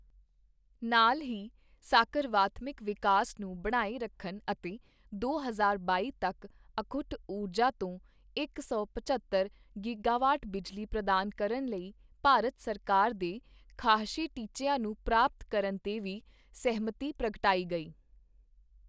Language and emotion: Punjabi, neutral